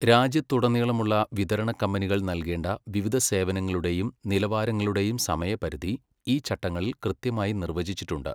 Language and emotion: Malayalam, neutral